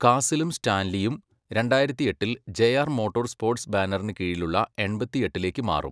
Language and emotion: Malayalam, neutral